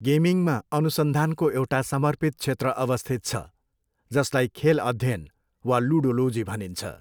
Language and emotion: Nepali, neutral